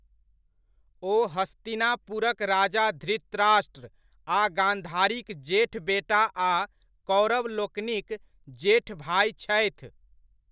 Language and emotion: Maithili, neutral